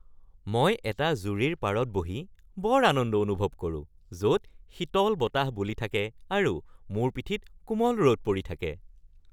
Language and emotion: Assamese, happy